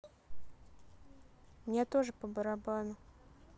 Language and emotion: Russian, neutral